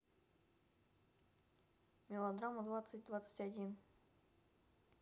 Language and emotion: Russian, neutral